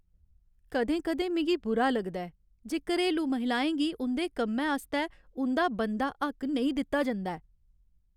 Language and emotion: Dogri, sad